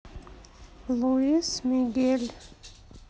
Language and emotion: Russian, sad